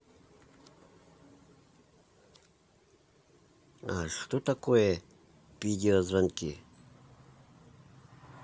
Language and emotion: Russian, neutral